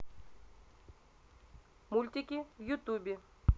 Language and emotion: Russian, neutral